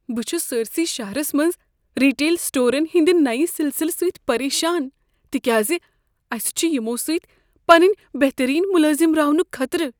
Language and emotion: Kashmiri, fearful